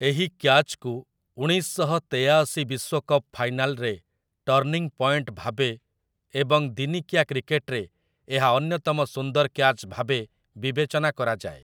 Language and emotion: Odia, neutral